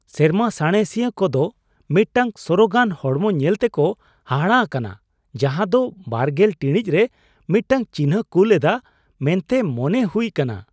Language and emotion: Santali, surprised